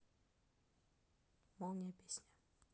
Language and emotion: Russian, neutral